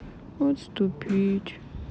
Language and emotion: Russian, sad